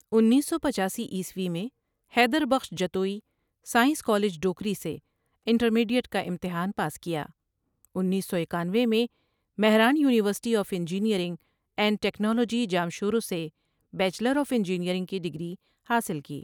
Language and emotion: Urdu, neutral